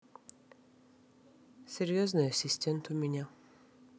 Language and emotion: Russian, sad